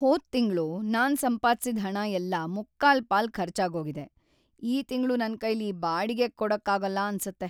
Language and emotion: Kannada, sad